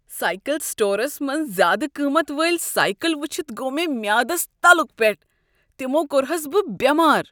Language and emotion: Kashmiri, disgusted